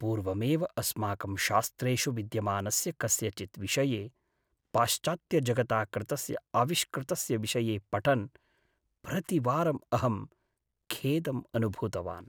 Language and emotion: Sanskrit, sad